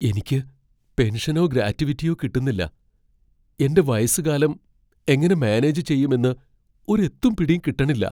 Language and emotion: Malayalam, fearful